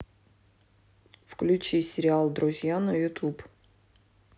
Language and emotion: Russian, neutral